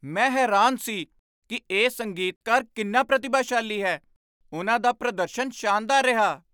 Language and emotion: Punjabi, surprised